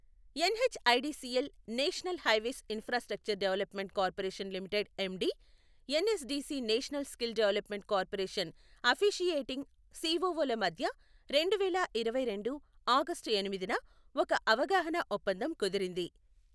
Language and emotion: Telugu, neutral